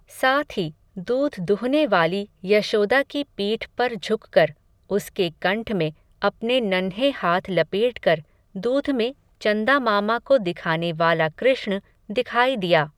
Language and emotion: Hindi, neutral